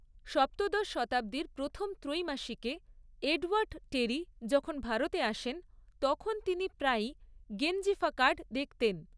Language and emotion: Bengali, neutral